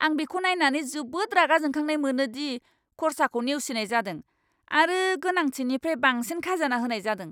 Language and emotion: Bodo, angry